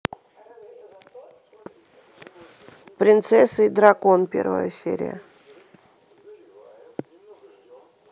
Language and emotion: Russian, neutral